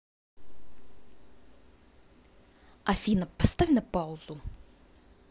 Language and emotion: Russian, angry